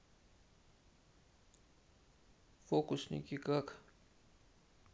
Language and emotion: Russian, neutral